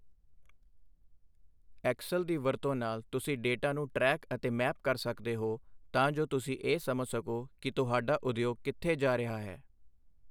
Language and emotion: Punjabi, neutral